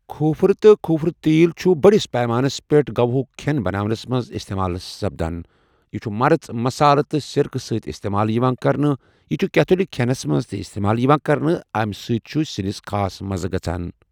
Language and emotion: Kashmiri, neutral